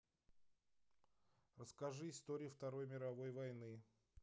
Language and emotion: Russian, neutral